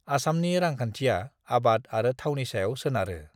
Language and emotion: Bodo, neutral